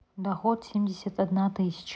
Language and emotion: Russian, neutral